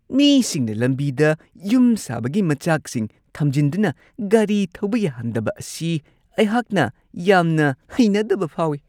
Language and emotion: Manipuri, disgusted